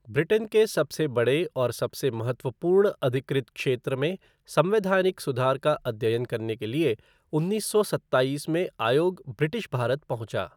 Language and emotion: Hindi, neutral